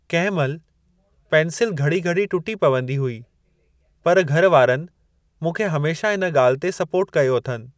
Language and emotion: Sindhi, neutral